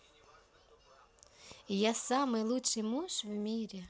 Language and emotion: Russian, neutral